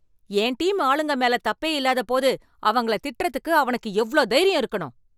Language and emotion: Tamil, angry